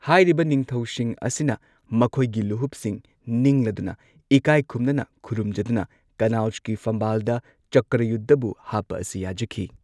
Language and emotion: Manipuri, neutral